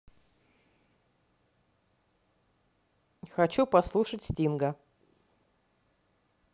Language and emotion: Russian, neutral